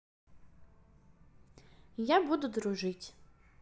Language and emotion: Russian, neutral